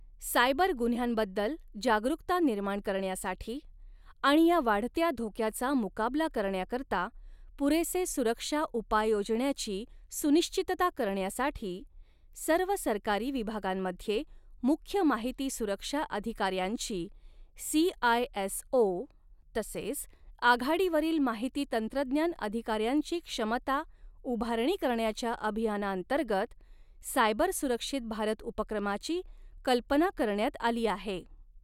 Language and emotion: Marathi, neutral